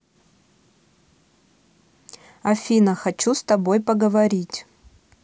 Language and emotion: Russian, neutral